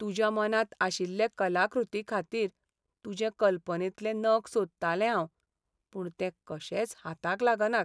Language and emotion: Goan Konkani, sad